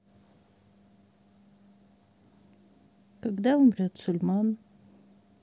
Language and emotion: Russian, sad